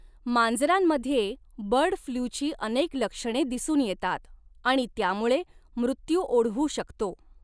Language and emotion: Marathi, neutral